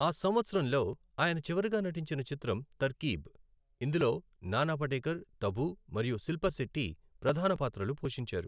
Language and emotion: Telugu, neutral